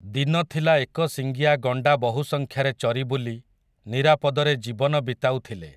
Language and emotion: Odia, neutral